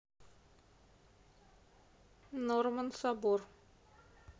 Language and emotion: Russian, neutral